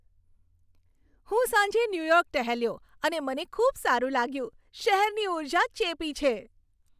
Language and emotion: Gujarati, happy